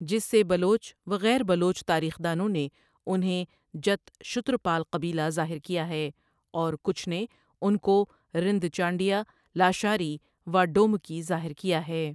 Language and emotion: Urdu, neutral